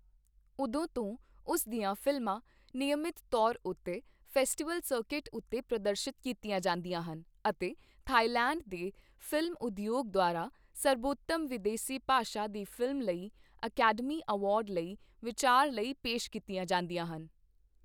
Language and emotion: Punjabi, neutral